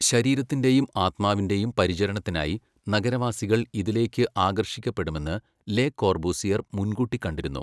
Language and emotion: Malayalam, neutral